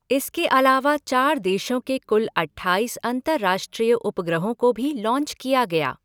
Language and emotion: Hindi, neutral